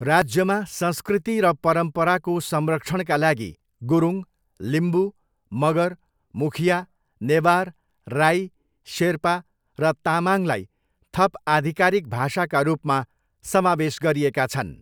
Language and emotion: Nepali, neutral